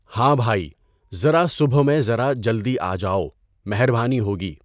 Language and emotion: Urdu, neutral